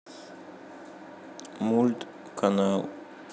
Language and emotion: Russian, sad